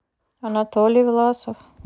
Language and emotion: Russian, neutral